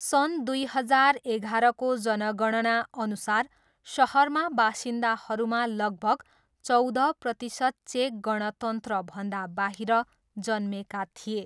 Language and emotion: Nepali, neutral